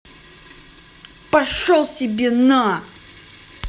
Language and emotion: Russian, angry